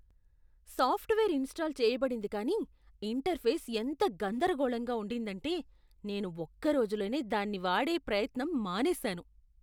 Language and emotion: Telugu, disgusted